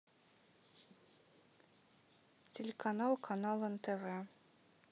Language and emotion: Russian, neutral